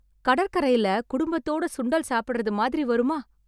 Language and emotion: Tamil, happy